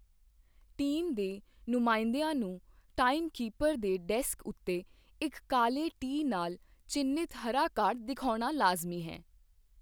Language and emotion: Punjabi, neutral